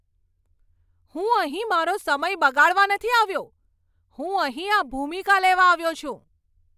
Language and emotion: Gujarati, angry